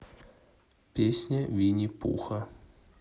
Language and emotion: Russian, neutral